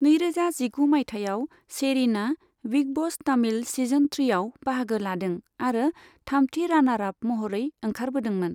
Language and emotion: Bodo, neutral